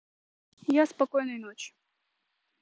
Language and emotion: Russian, neutral